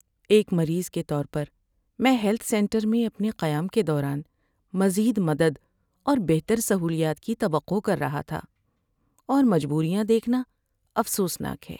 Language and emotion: Urdu, sad